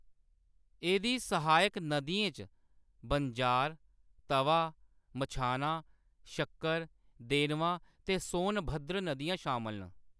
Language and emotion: Dogri, neutral